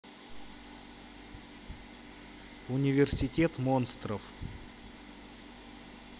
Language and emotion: Russian, neutral